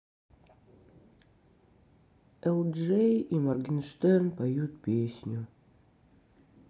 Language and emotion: Russian, sad